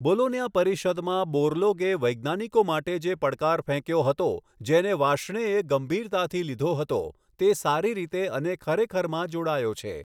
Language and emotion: Gujarati, neutral